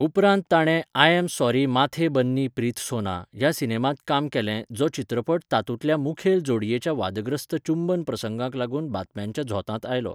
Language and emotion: Goan Konkani, neutral